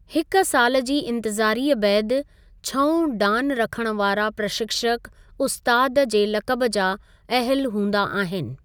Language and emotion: Sindhi, neutral